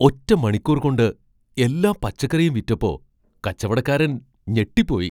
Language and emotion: Malayalam, surprised